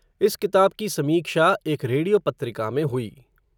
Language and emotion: Hindi, neutral